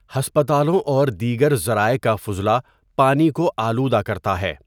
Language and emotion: Urdu, neutral